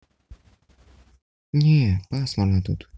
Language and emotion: Russian, sad